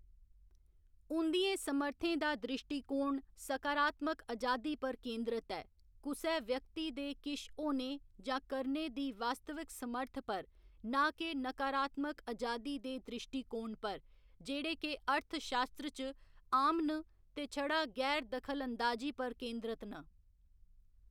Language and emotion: Dogri, neutral